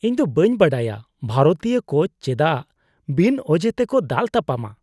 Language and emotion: Santali, disgusted